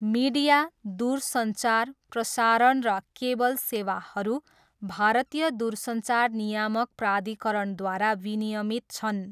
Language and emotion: Nepali, neutral